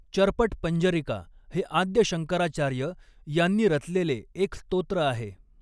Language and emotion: Marathi, neutral